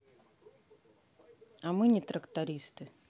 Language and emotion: Russian, neutral